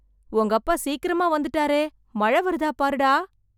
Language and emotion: Tamil, surprised